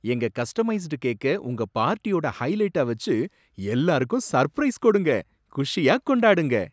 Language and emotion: Tamil, surprised